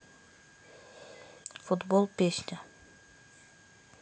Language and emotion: Russian, neutral